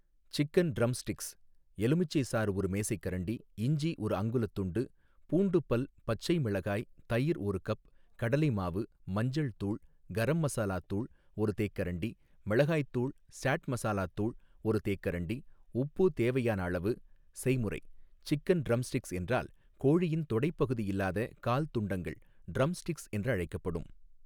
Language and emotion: Tamil, neutral